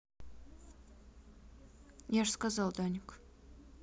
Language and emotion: Russian, neutral